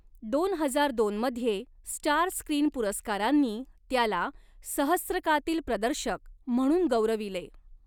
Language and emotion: Marathi, neutral